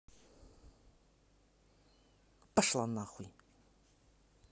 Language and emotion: Russian, angry